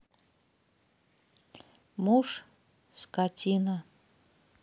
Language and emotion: Russian, neutral